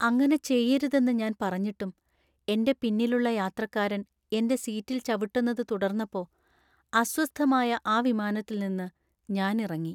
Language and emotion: Malayalam, sad